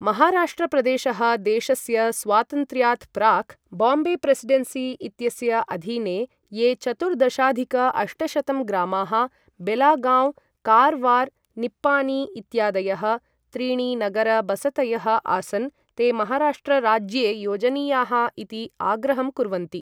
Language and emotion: Sanskrit, neutral